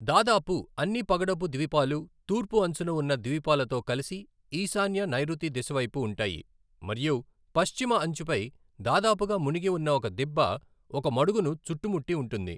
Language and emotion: Telugu, neutral